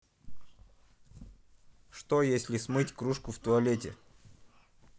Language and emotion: Russian, neutral